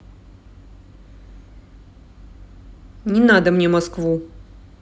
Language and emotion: Russian, angry